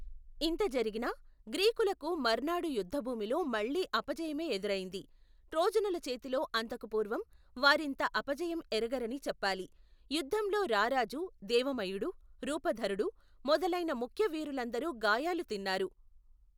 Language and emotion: Telugu, neutral